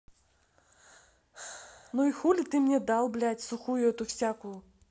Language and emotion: Russian, angry